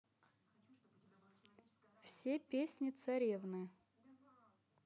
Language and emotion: Russian, neutral